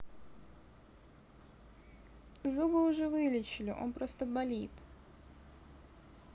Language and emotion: Russian, neutral